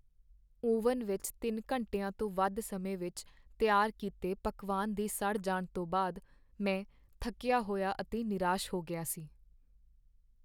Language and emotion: Punjabi, sad